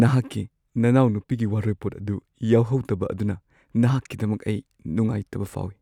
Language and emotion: Manipuri, sad